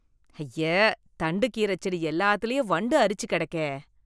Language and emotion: Tamil, disgusted